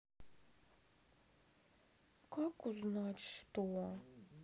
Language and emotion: Russian, sad